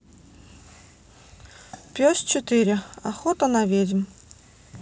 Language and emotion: Russian, neutral